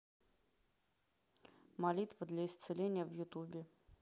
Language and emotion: Russian, neutral